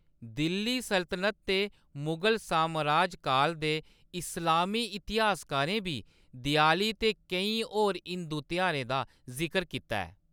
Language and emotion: Dogri, neutral